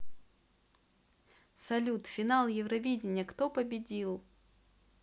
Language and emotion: Russian, positive